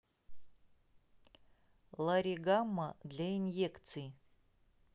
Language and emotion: Russian, neutral